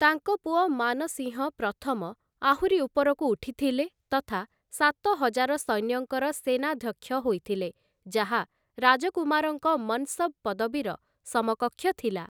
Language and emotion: Odia, neutral